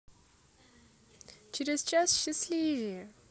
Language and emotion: Russian, positive